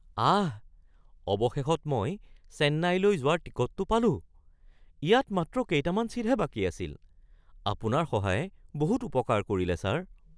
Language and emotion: Assamese, surprised